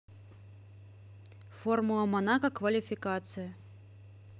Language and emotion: Russian, neutral